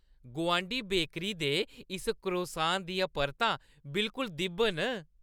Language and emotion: Dogri, happy